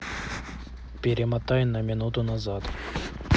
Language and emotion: Russian, neutral